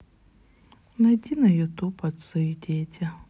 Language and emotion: Russian, sad